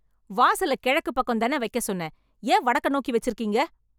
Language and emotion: Tamil, angry